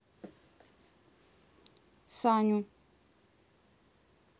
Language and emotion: Russian, neutral